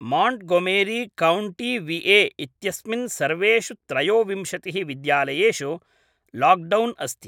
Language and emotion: Sanskrit, neutral